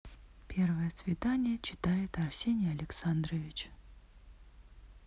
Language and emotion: Russian, neutral